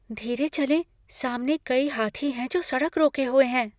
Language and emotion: Hindi, fearful